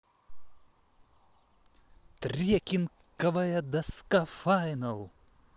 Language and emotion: Russian, positive